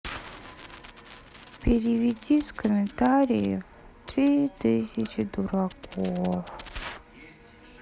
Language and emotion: Russian, sad